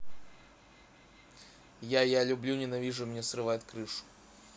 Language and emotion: Russian, neutral